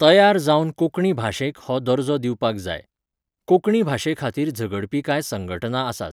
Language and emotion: Goan Konkani, neutral